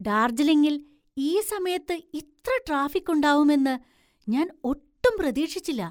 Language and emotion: Malayalam, surprised